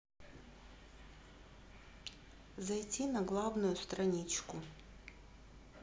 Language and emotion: Russian, neutral